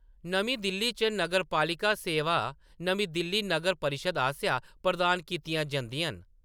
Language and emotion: Dogri, neutral